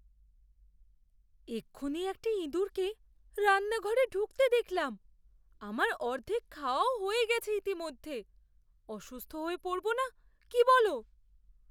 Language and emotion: Bengali, fearful